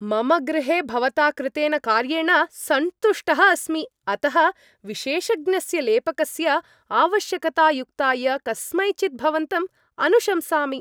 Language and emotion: Sanskrit, happy